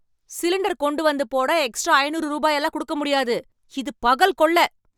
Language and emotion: Tamil, angry